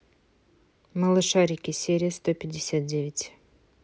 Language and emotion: Russian, neutral